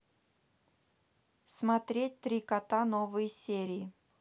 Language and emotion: Russian, neutral